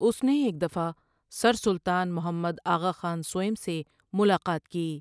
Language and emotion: Urdu, neutral